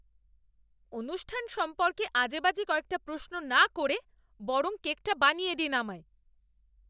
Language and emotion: Bengali, angry